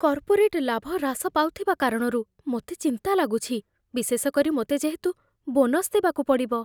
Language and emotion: Odia, fearful